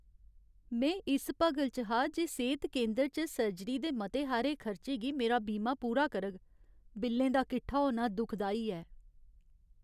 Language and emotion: Dogri, sad